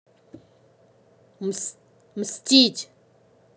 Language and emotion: Russian, angry